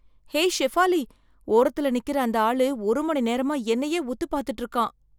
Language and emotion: Tamil, fearful